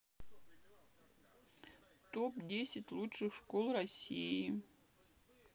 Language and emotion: Russian, sad